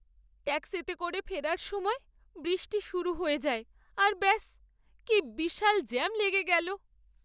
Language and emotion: Bengali, sad